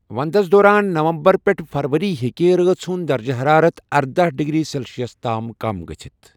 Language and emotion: Kashmiri, neutral